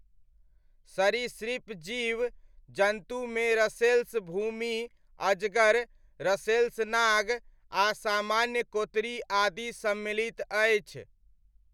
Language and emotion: Maithili, neutral